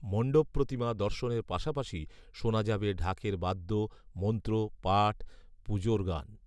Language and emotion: Bengali, neutral